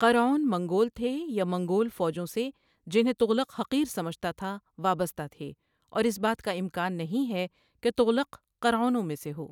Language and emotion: Urdu, neutral